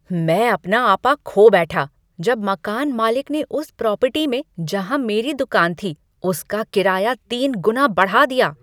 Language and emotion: Hindi, angry